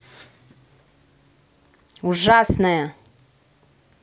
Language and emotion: Russian, angry